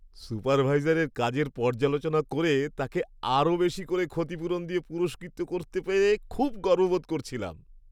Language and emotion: Bengali, happy